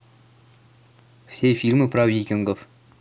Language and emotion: Russian, neutral